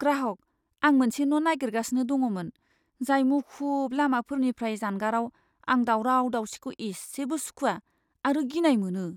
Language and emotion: Bodo, fearful